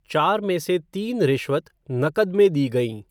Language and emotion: Hindi, neutral